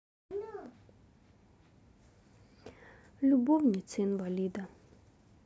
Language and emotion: Russian, sad